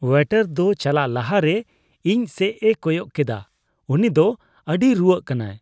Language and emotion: Santali, disgusted